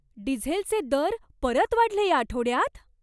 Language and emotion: Marathi, surprised